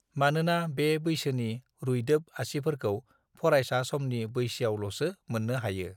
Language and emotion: Bodo, neutral